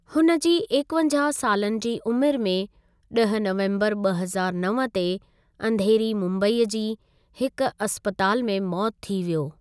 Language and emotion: Sindhi, neutral